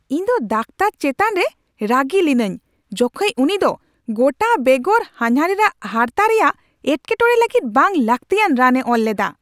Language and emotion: Santali, angry